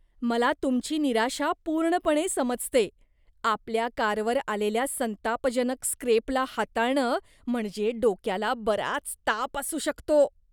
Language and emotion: Marathi, disgusted